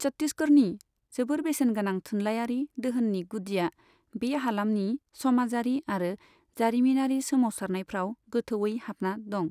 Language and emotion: Bodo, neutral